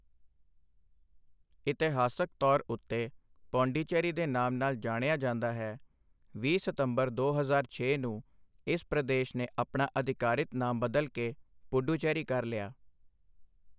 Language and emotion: Punjabi, neutral